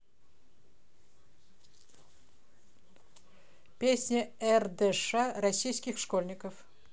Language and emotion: Russian, neutral